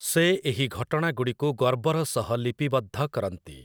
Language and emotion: Odia, neutral